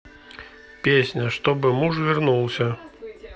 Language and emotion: Russian, neutral